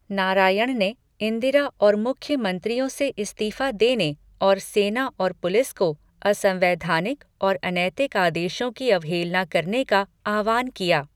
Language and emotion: Hindi, neutral